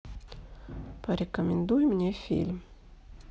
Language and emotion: Russian, neutral